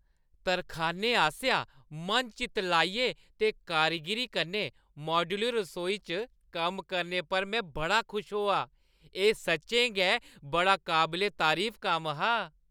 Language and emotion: Dogri, happy